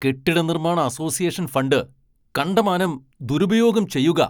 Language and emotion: Malayalam, angry